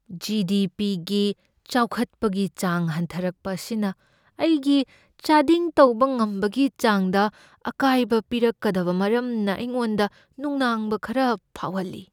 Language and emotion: Manipuri, fearful